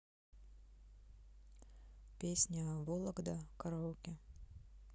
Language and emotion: Russian, neutral